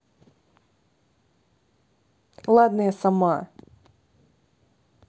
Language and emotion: Russian, angry